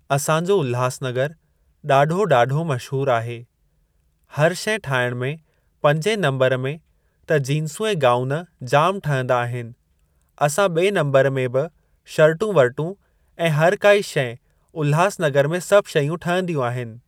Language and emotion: Sindhi, neutral